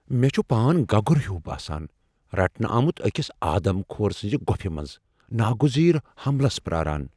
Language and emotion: Kashmiri, fearful